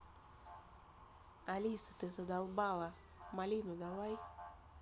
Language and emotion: Russian, angry